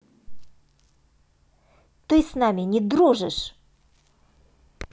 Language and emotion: Russian, angry